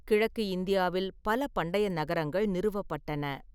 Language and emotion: Tamil, neutral